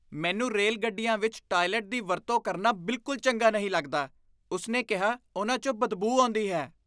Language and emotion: Punjabi, disgusted